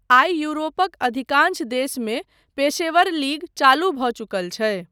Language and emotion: Maithili, neutral